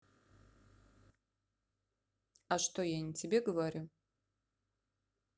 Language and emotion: Russian, neutral